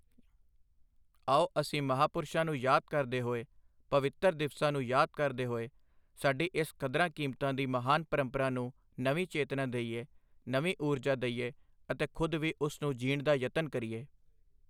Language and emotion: Punjabi, neutral